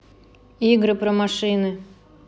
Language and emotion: Russian, neutral